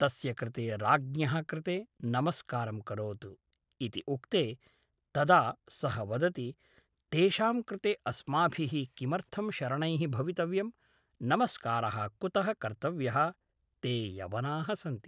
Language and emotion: Sanskrit, neutral